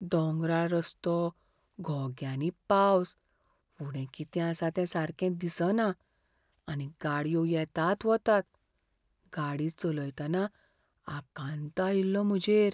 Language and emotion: Goan Konkani, fearful